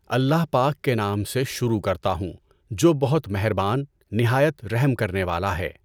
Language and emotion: Urdu, neutral